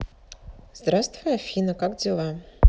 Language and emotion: Russian, neutral